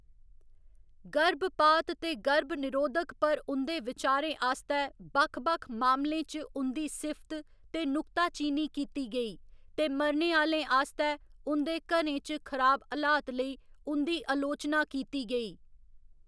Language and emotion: Dogri, neutral